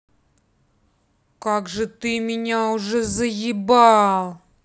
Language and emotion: Russian, angry